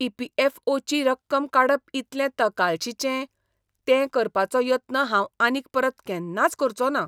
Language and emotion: Goan Konkani, disgusted